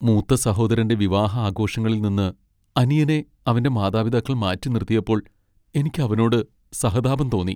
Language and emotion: Malayalam, sad